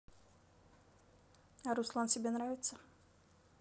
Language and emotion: Russian, neutral